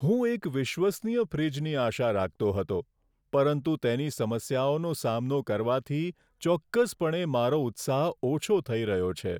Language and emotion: Gujarati, sad